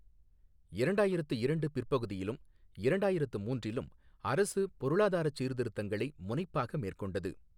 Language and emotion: Tamil, neutral